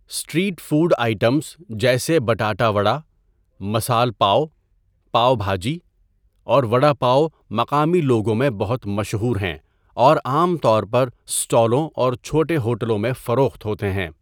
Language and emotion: Urdu, neutral